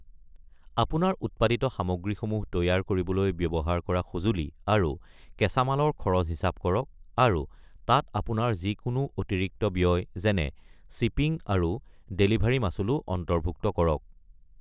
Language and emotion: Assamese, neutral